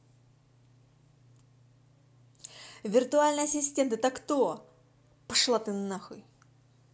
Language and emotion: Russian, angry